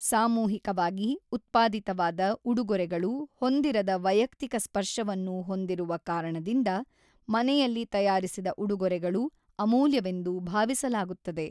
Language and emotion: Kannada, neutral